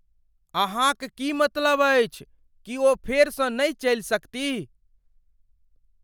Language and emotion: Maithili, fearful